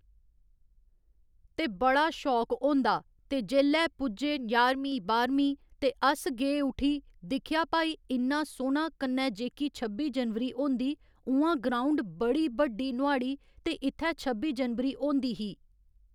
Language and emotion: Dogri, neutral